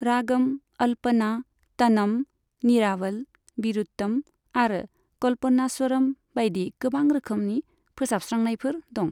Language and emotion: Bodo, neutral